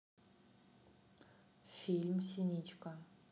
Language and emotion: Russian, neutral